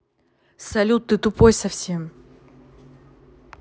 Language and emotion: Russian, angry